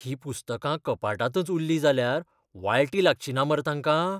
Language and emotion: Goan Konkani, fearful